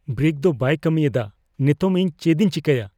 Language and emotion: Santali, fearful